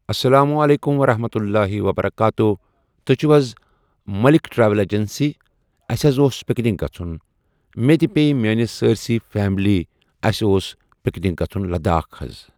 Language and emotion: Kashmiri, neutral